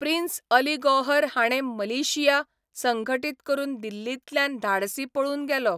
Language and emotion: Goan Konkani, neutral